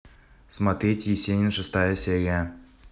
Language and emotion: Russian, neutral